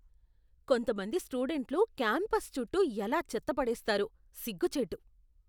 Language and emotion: Telugu, disgusted